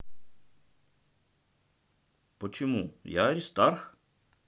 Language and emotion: Russian, neutral